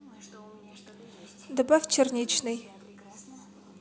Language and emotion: Russian, neutral